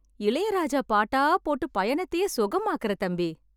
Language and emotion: Tamil, happy